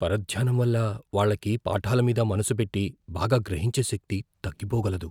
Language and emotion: Telugu, fearful